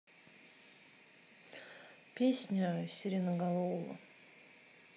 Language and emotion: Russian, sad